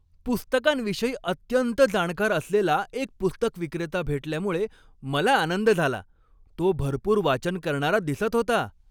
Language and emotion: Marathi, happy